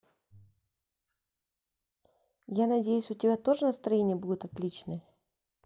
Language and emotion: Russian, neutral